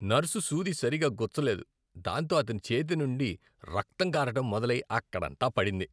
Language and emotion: Telugu, disgusted